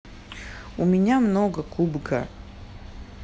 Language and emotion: Russian, neutral